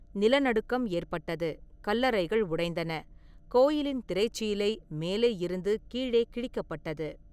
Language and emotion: Tamil, neutral